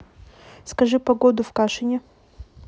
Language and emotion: Russian, neutral